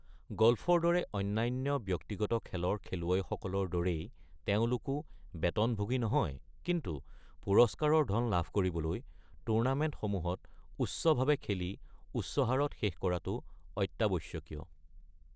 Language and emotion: Assamese, neutral